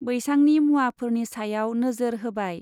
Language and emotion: Bodo, neutral